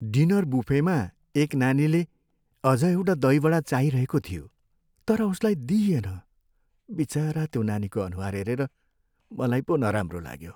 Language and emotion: Nepali, sad